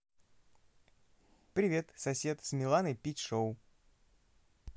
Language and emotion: Russian, positive